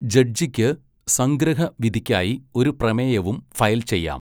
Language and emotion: Malayalam, neutral